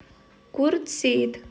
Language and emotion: Russian, neutral